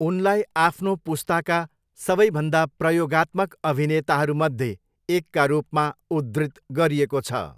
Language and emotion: Nepali, neutral